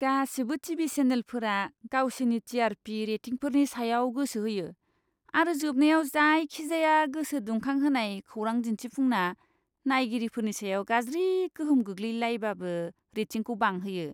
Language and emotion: Bodo, disgusted